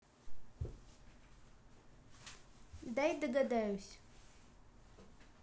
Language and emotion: Russian, neutral